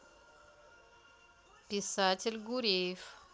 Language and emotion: Russian, neutral